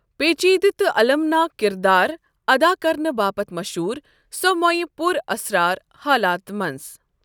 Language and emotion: Kashmiri, neutral